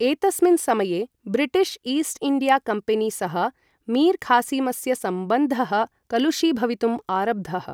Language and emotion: Sanskrit, neutral